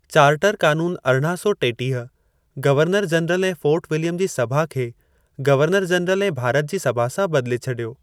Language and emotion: Sindhi, neutral